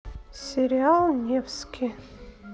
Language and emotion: Russian, neutral